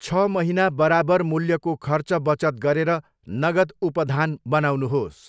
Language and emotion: Nepali, neutral